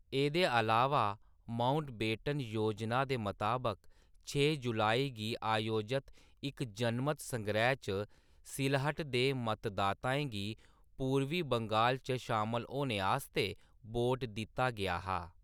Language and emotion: Dogri, neutral